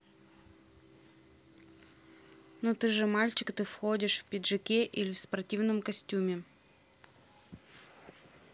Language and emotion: Russian, neutral